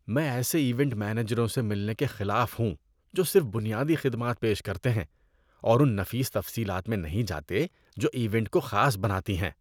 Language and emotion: Urdu, disgusted